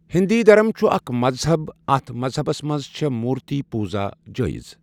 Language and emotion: Kashmiri, neutral